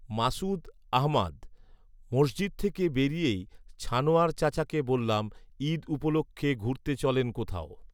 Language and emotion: Bengali, neutral